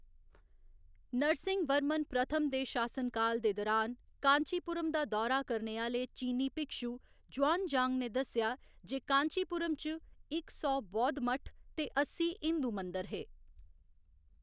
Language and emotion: Dogri, neutral